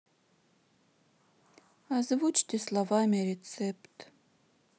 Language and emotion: Russian, sad